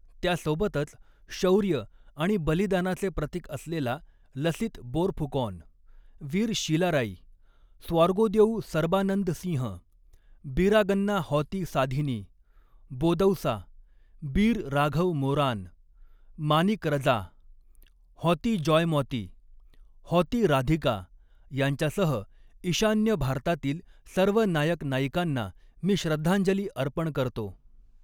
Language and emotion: Marathi, neutral